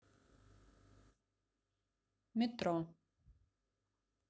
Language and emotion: Russian, neutral